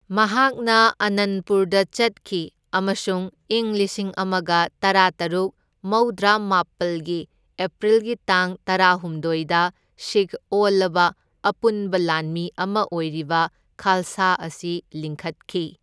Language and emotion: Manipuri, neutral